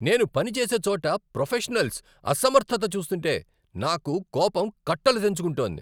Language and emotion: Telugu, angry